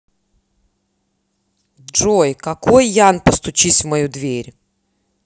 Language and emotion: Russian, angry